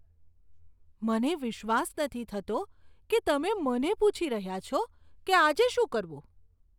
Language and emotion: Gujarati, disgusted